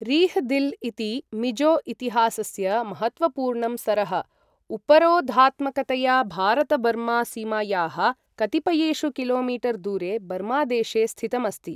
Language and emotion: Sanskrit, neutral